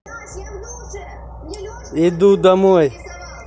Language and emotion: Russian, neutral